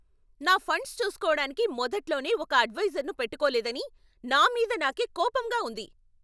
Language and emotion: Telugu, angry